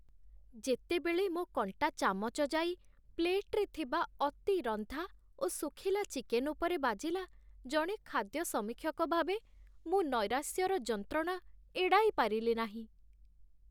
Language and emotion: Odia, sad